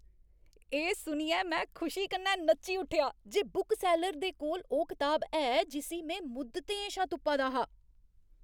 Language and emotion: Dogri, happy